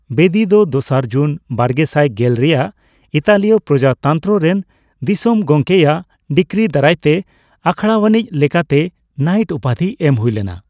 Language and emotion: Santali, neutral